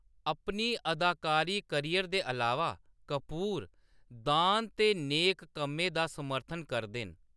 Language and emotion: Dogri, neutral